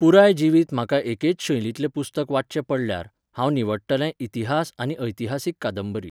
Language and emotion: Goan Konkani, neutral